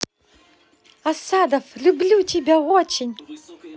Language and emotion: Russian, positive